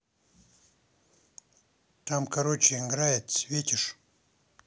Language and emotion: Russian, neutral